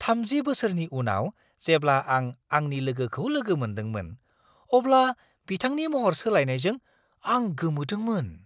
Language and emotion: Bodo, surprised